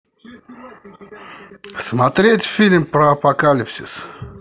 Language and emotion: Russian, positive